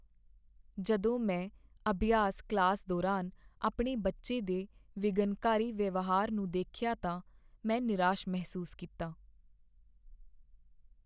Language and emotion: Punjabi, sad